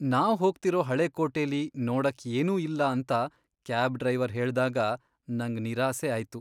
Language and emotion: Kannada, sad